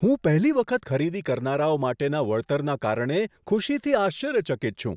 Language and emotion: Gujarati, surprised